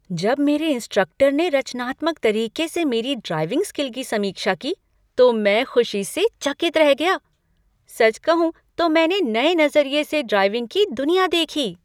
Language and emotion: Hindi, surprised